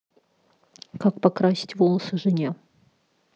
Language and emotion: Russian, neutral